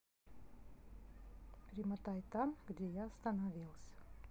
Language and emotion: Russian, neutral